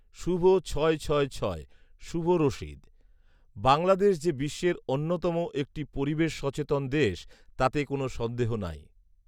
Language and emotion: Bengali, neutral